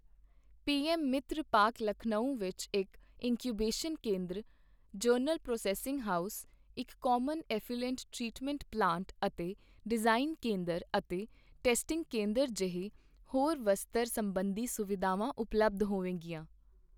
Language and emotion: Punjabi, neutral